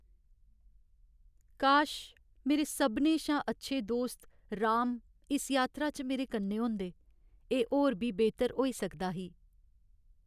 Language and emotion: Dogri, sad